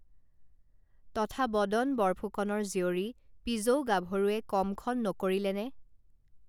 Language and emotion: Assamese, neutral